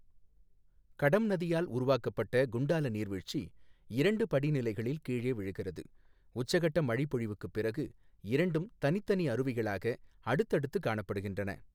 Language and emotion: Tamil, neutral